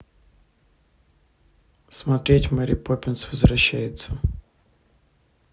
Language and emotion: Russian, neutral